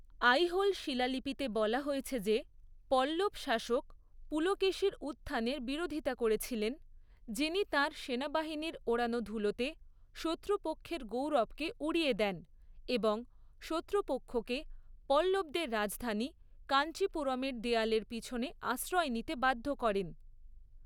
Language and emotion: Bengali, neutral